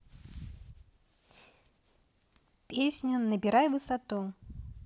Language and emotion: Russian, neutral